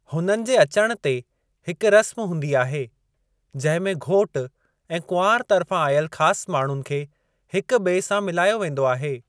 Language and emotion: Sindhi, neutral